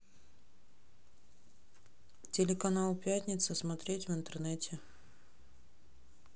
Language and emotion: Russian, neutral